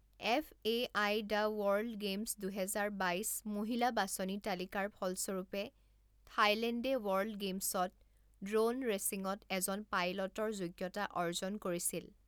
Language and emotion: Assamese, neutral